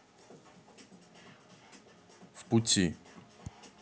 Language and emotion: Russian, neutral